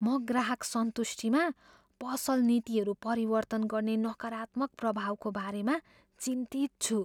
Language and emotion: Nepali, fearful